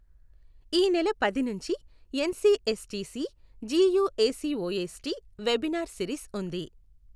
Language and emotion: Telugu, neutral